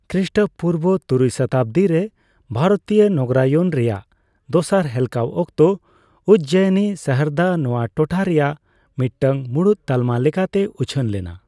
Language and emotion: Santali, neutral